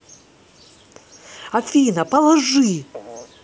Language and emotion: Russian, angry